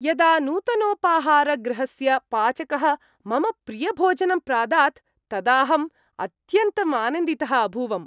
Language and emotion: Sanskrit, happy